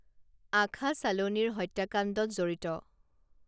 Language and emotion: Assamese, neutral